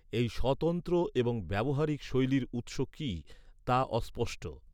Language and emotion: Bengali, neutral